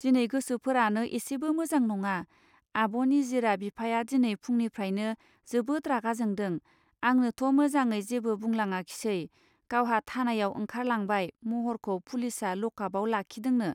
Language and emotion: Bodo, neutral